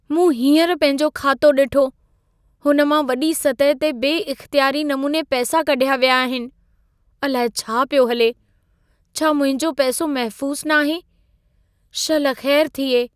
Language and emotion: Sindhi, fearful